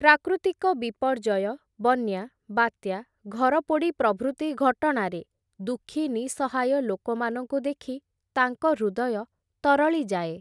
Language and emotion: Odia, neutral